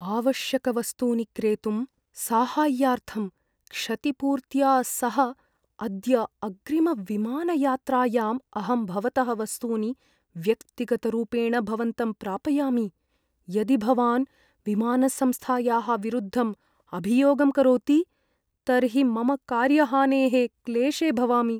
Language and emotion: Sanskrit, fearful